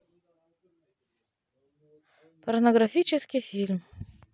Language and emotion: Russian, neutral